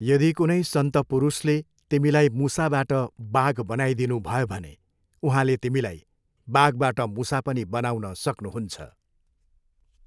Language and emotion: Nepali, neutral